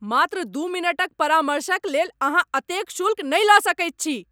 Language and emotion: Maithili, angry